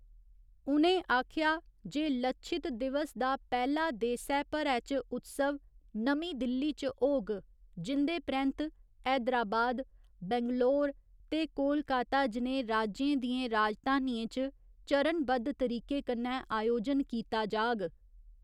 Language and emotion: Dogri, neutral